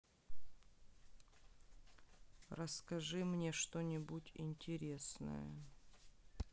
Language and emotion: Russian, sad